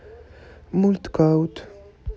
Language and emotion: Russian, neutral